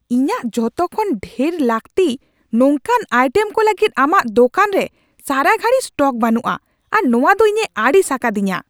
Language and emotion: Santali, angry